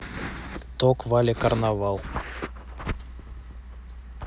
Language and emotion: Russian, neutral